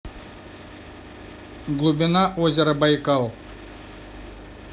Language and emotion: Russian, neutral